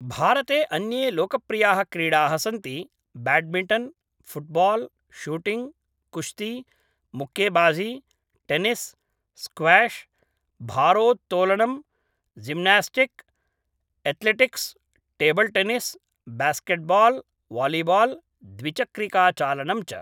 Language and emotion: Sanskrit, neutral